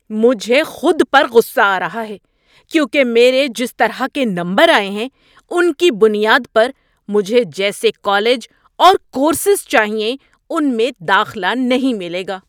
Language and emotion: Urdu, angry